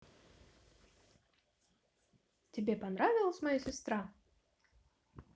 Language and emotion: Russian, positive